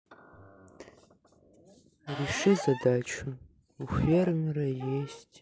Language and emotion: Russian, sad